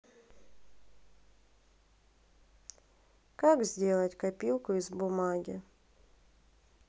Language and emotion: Russian, sad